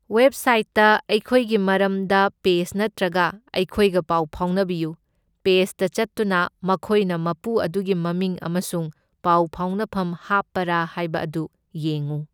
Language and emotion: Manipuri, neutral